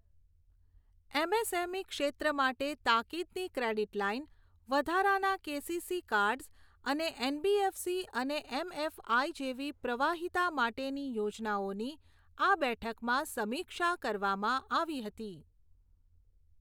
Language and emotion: Gujarati, neutral